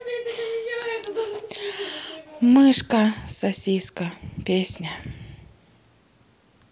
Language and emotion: Russian, neutral